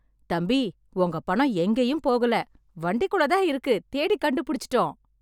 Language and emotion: Tamil, happy